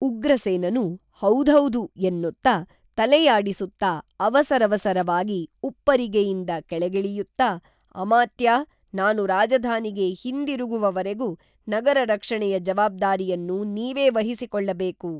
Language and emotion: Kannada, neutral